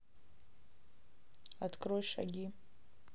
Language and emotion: Russian, neutral